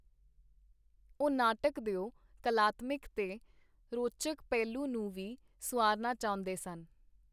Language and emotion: Punjabi, neutral